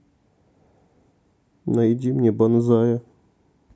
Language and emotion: Russian, sad